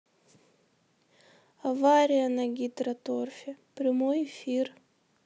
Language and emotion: Russian, sad